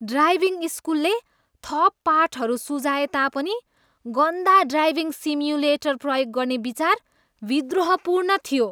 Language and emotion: Nepali, disgusted